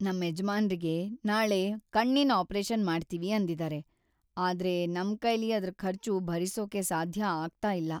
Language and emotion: Kannada, sad